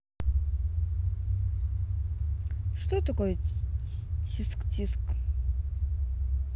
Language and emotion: Russian, neutral